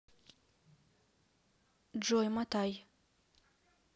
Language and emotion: Russian, neutral